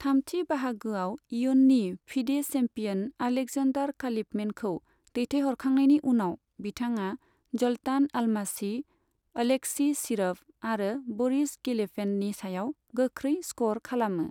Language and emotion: Bodo, neutral